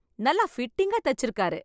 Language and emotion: Tamil, happy